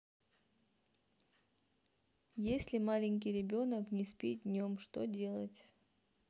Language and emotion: Russian, neutral